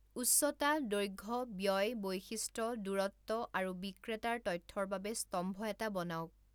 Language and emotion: Assamese, neutral